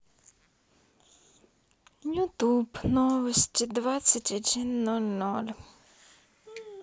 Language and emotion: Russian, sad